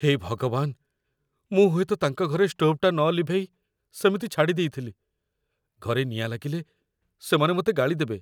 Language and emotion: Odia, fearful